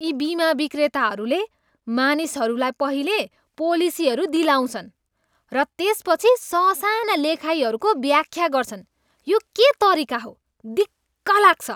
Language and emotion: Nepali, disgusted